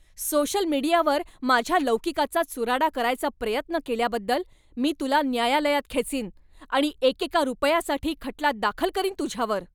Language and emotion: Marathi, angry